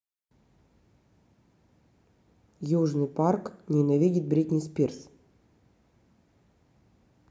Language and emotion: Russian, neutral